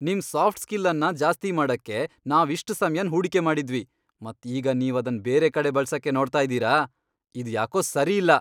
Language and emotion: Kannada, angry